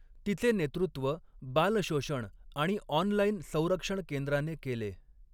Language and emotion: Marathi, neutral